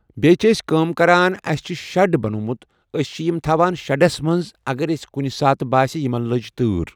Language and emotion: Kashmiri, neutral